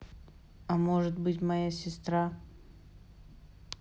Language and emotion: Russian, sad